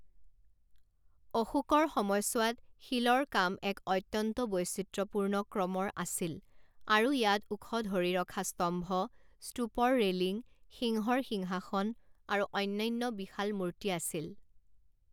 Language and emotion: Assamese, neutral